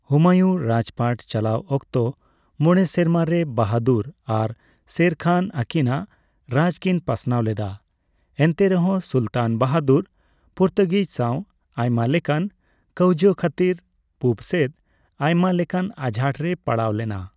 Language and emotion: Santali, neutral